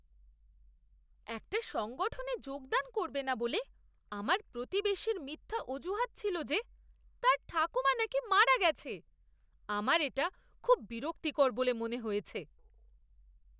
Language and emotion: Bengali, disgusted